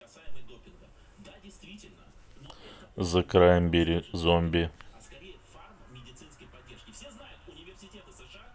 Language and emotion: Russian, neutral